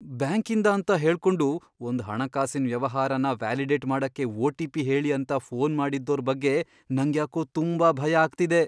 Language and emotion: Kannada, fearful